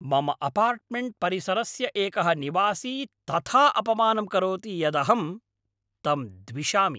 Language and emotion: Sanskrit, angry